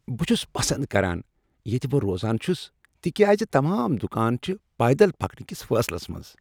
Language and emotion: Kashmiri, happy